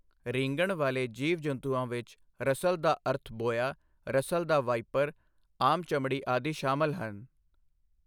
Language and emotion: Punjabi, neutral